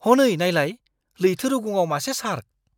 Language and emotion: Bodo, surprised